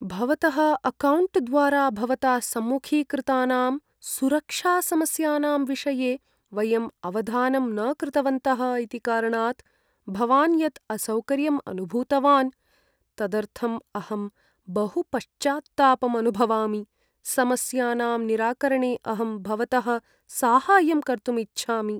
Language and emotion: Sanskrit, sad